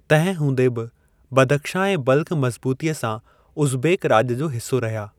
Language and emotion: Sindhi, neutral